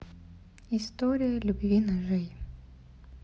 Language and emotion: Russian, sad